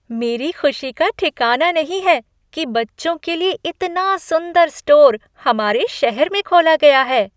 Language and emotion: Hindi, happy